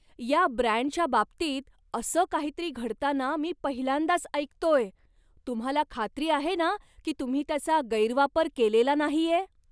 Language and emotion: Marathi, surprised